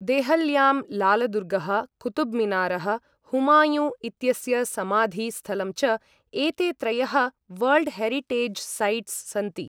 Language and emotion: Sanskrit, neutral